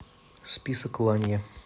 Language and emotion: Russian, neutral